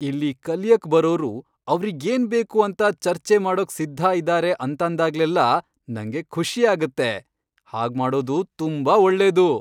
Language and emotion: Kannada, happy